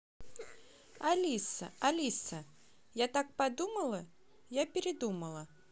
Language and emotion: Russian, neutral